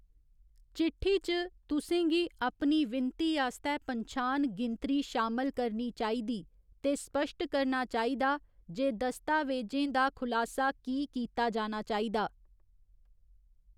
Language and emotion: Dogri, neutral